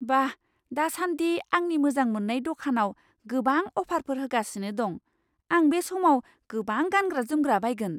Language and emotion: Bodo, surprised